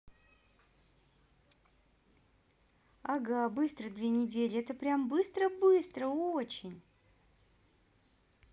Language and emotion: Russian, positive